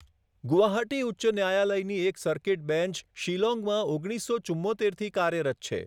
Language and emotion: Gujarati, neutral